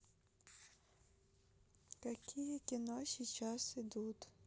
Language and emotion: Russian, sad